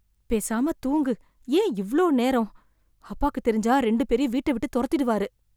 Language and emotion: Tamil, fearful